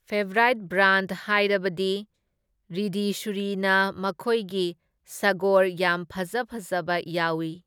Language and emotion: Manipuri, neutral